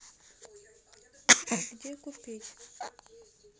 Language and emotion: Russian, neutral